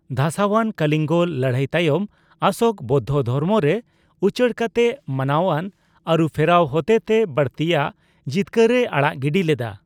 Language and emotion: Santali, neutral